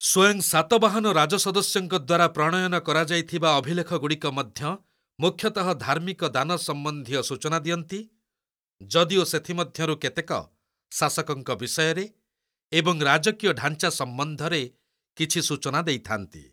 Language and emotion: Odia, neutral